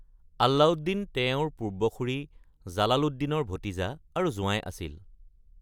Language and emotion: Assamese, neutral